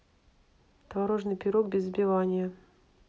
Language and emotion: Russian, neutral